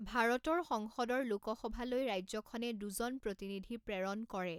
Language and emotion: Assamese, neutral